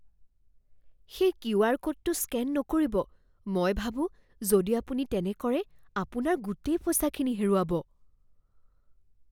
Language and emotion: Assamese, fearful